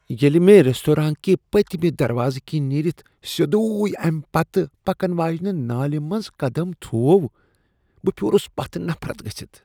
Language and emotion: Kashmiri, disgusted